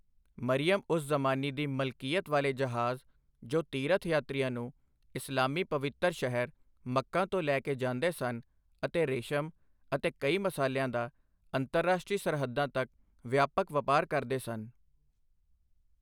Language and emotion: Punjabi, neutral